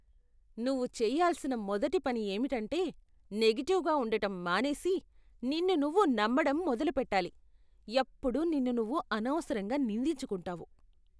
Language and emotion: Telugu, disgusted